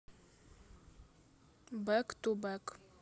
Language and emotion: Russian, neutral